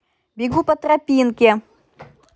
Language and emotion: Russian, positive